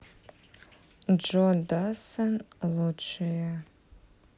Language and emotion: Russian, neutral